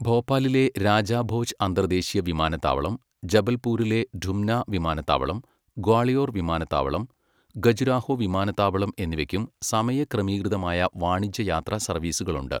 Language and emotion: Malayalam, neutral